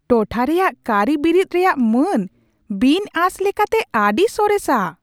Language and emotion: Santali, surprised